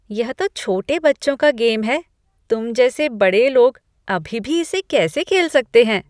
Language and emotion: Hindi, disgusted